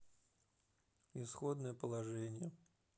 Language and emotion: Russian, neutral